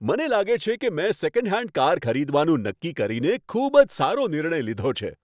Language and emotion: Gujarati, happy